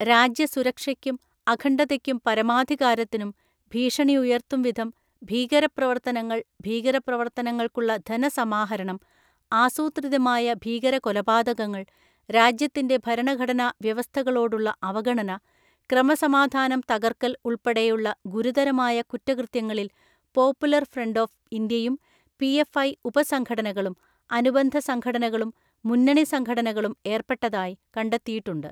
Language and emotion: Malayalam, neutral